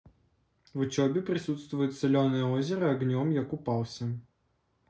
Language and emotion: Russian, neutral